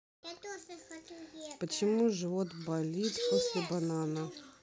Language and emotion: Russian, neutral